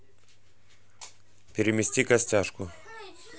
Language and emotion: Russian, neutral